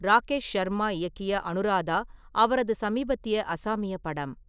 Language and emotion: Tamil, neutral